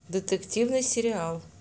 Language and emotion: Russian, neutral